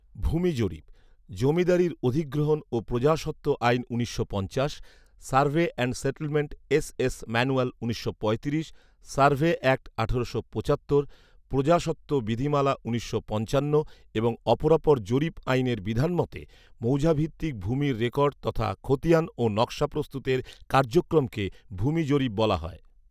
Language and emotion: Bengali, neutral